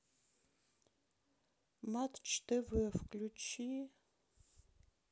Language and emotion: Russian, sad